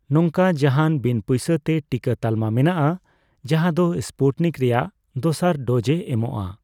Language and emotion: Santali, neutral